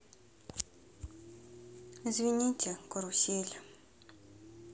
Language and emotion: Russian, sad